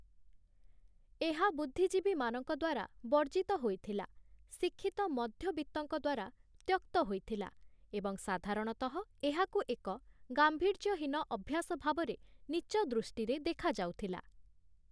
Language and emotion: Odia, neutral